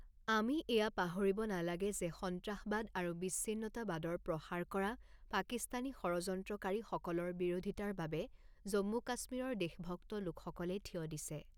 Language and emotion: Assamese, neutral